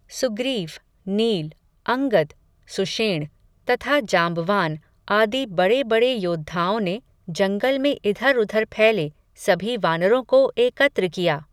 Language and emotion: Hindi, neutral